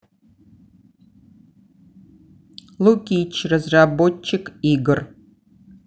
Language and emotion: Russian, neutral